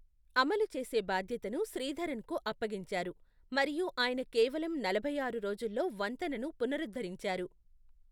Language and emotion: Telugu, neutral